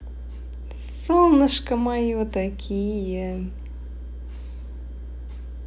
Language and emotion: Russian, positive